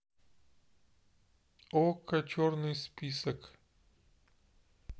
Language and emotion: Russian, neutral